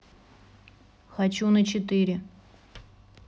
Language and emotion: Russian, neutral